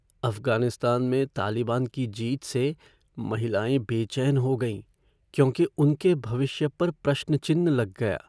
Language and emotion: Hindi, fearful